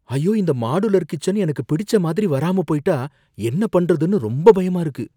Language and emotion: Tamil, fearful